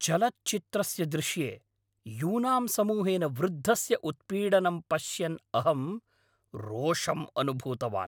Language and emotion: Sanskrit, angry